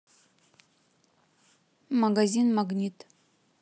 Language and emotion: Russian, neutral